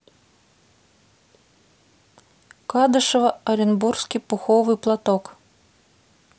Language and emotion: Russian, neutral